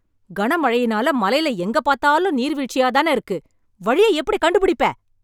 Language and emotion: Tamil, angry